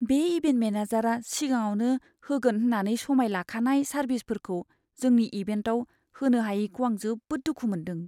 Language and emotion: Bodo, sad